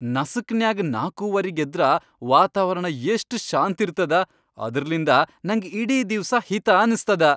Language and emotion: Kannada, happy